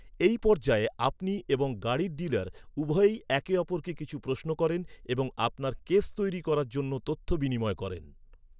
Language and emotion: Bengali, neutral